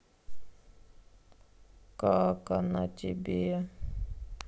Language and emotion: Russian, sad